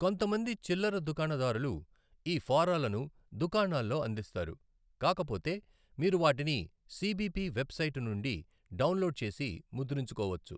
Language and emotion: Telugu, neutral